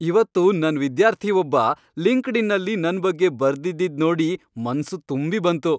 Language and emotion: Kannada, happy